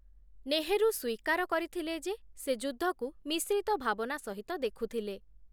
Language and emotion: Odia, neutral